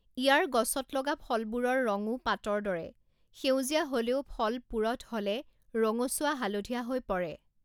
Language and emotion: Assamese, neutral